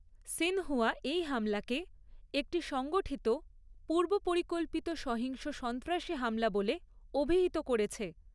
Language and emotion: Bengali, neutral